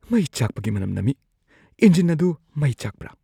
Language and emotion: Manipuri, fearful